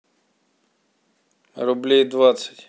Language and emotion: Russian, neutral